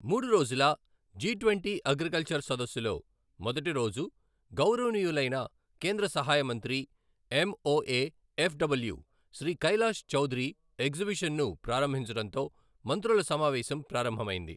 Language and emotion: Telugu, neutral